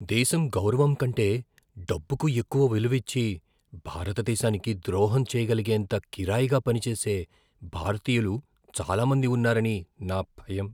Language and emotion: Telugu, fearful